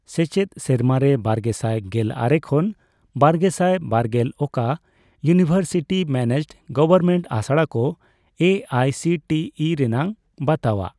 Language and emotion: Santali, neutral